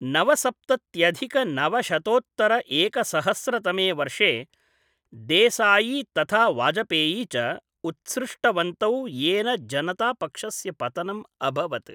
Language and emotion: Sanskrit, neutral